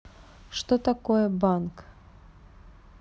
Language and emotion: Russian, neutral